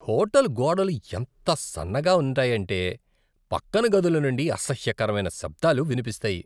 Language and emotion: Telugu, disgusted